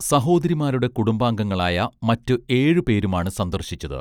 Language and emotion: Malayalam, neutral